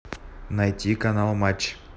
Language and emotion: Russian, neutral